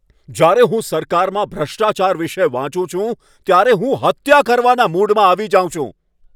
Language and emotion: Gujarati, angry